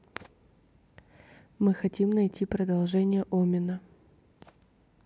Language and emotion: Russian, neutral